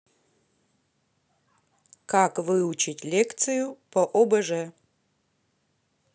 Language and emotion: Russian, neutral